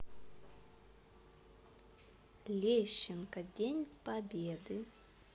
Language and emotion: Russian, positive